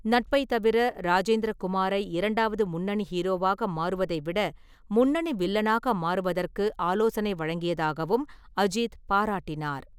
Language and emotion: Tamil, neutral